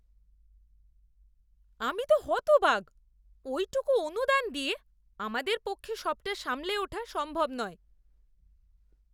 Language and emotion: Bengali, disgusted